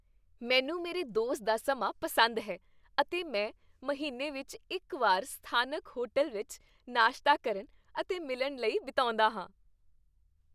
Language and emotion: Punjabi, happy